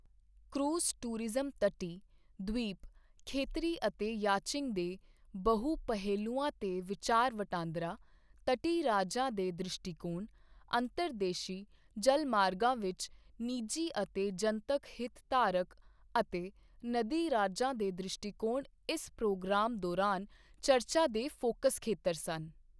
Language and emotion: Punjabi, neutral